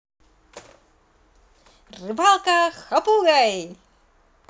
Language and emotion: Russian, positive